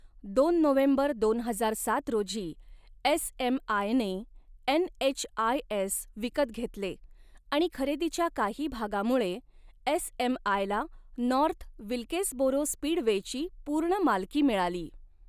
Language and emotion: Marathi, neutral